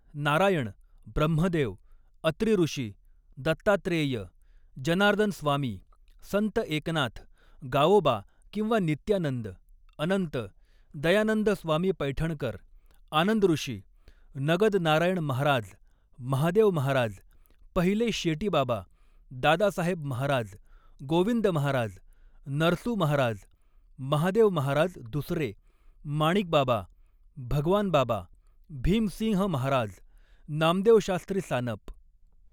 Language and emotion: Marathi, neutral